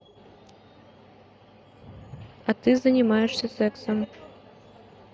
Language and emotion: Russian, neutral